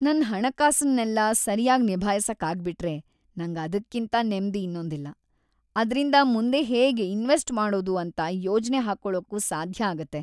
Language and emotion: Kannada, happy